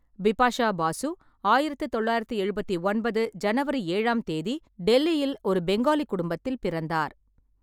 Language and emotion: Tamil, neutral